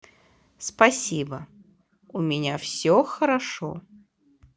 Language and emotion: Russian, positive